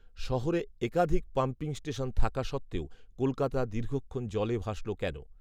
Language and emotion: Bengali, neutral